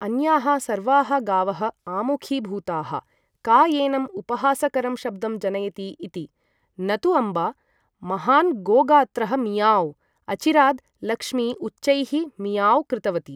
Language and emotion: Sanskrit, neutral